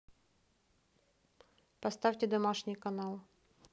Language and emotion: Russian, neutral